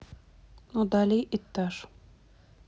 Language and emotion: Russian, neutral